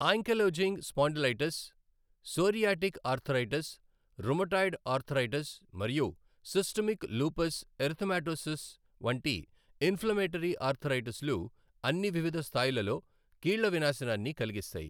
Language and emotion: Telugu, neutral